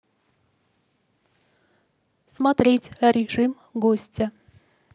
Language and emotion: Russian, neutral